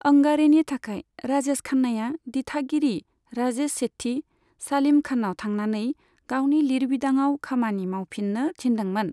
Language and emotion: Bodo, neutral